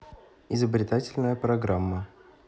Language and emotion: Russian, neutral